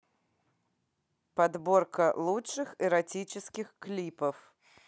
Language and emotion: Russian, neutral